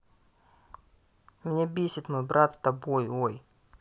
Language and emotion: Russian, angry